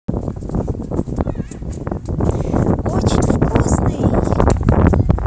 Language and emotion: Russian, positive